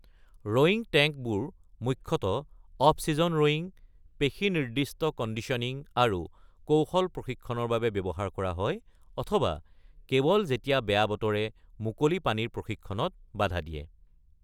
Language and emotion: Assamese, neutral